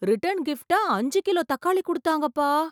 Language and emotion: Tamil, surprised